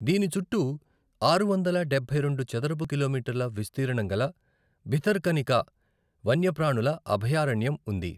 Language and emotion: Telugu, neutral